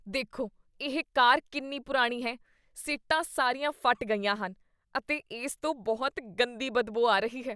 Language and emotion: Punjabi, disgusted